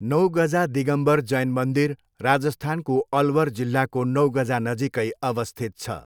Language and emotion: Nepali, neutral